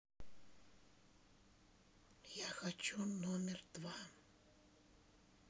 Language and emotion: Russian, neutral